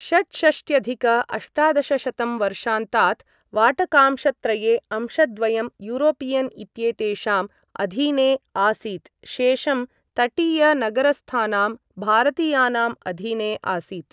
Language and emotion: Sanskrit, neutral